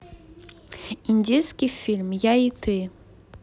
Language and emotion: Russian, neutral